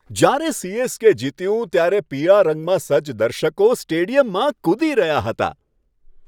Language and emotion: Gujarati, happy